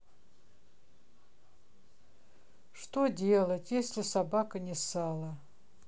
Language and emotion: Russian, sad